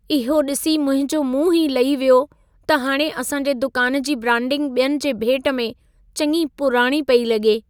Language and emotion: Sindhi, sad